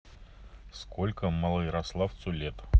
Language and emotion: Russian, neutral